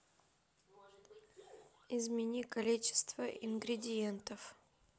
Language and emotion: Russian, neutral